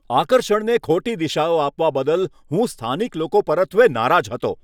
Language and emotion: Gujarati, angry